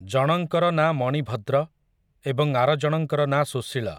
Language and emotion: Odia, neutral